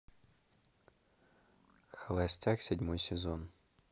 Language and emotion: Russian, neutral